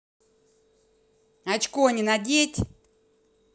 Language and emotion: Russian, angry